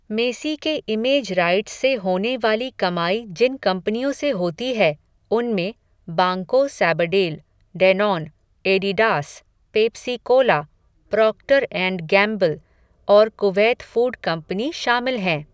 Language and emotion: Hindi, neutral